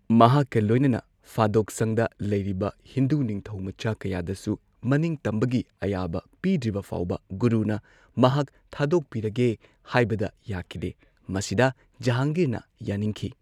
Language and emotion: Manipuri, neutral